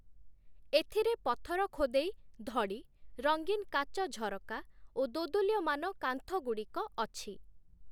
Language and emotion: Odia, neutral